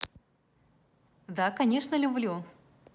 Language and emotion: Russian, positive